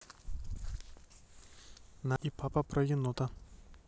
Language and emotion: Russian, neutral